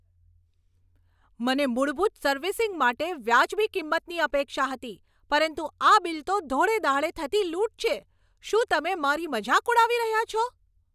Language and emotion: Gujarati, angry